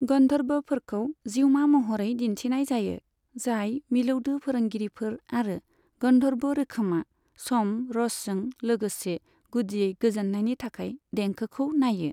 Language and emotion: Bodo, neutral